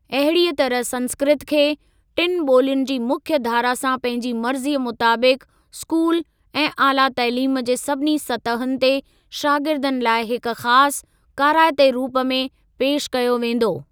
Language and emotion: Sindhi, neutral